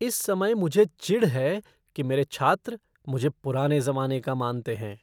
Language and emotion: Hindi, disgusted